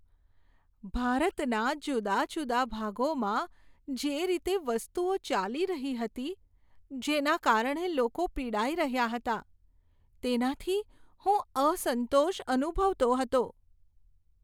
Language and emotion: Gujarati, sad